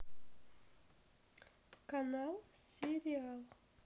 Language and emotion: Russian, neutral